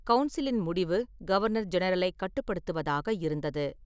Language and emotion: Tamil, neutral